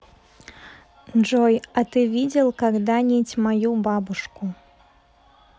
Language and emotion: Russian, neutral